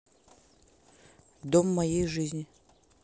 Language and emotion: Russian, neutral